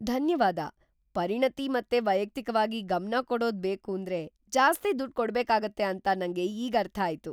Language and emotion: Kannada, surprised